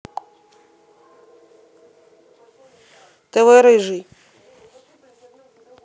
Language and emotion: Russian, neutral